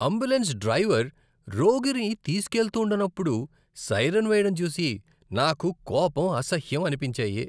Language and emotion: Telugu, disgusted